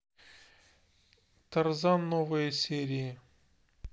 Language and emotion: Russian, neutral